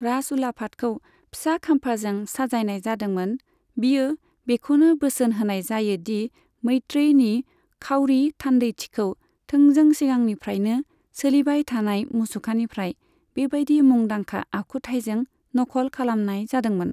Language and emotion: Bodo, neutral